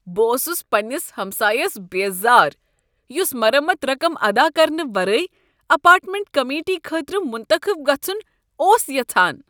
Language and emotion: Kashmiri, disgusted